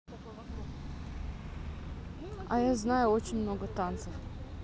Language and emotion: Russian, neutral